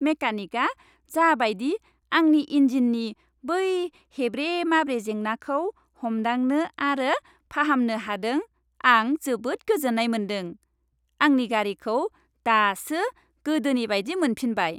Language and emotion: Bodo, happy